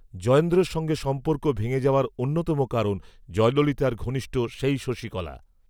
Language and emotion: Bengali, neutral